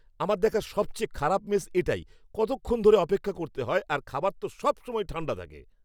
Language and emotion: Bengali, angry